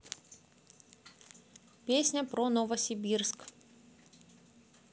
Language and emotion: Russian, neutral